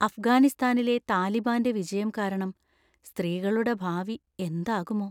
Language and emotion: Malayalam, fearful